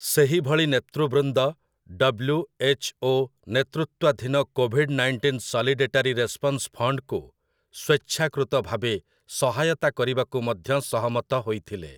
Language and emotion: Odia, neutral